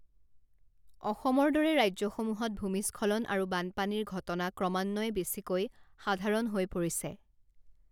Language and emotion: Assamese, neutral